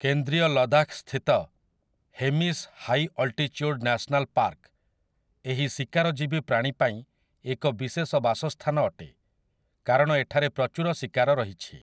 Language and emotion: Odia, neutral